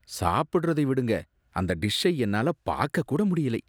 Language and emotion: Tamil, disgusted